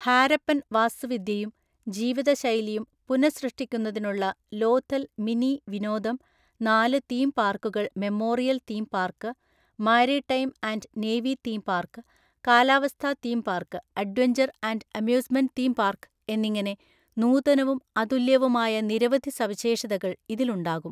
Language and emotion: Malayalam, neutral